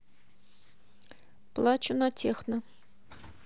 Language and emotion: Russian, neutral